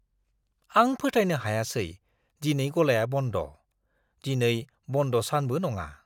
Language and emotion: Bodo, surprised